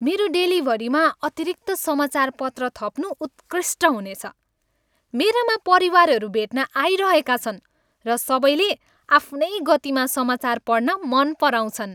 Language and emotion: Nepali, happy